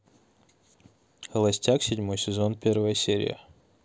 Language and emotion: Russian, neutral